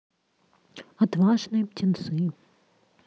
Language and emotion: Russian, neutral